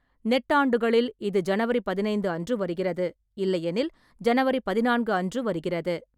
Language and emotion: Tamil, neutral